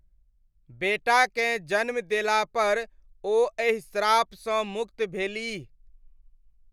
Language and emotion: Maithili, neutral